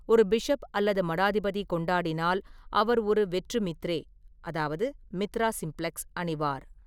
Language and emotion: Tamil, neutral